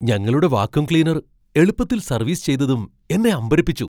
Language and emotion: Malayalam, surprised